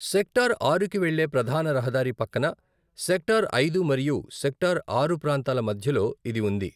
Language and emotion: Telugu, neutral